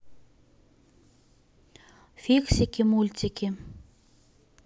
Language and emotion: Russian, neutral